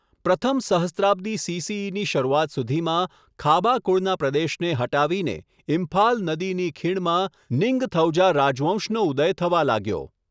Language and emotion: Gujarati, neutral